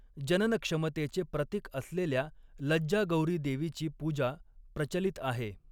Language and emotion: Marathi, neutral